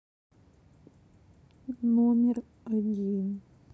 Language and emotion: Russian, sad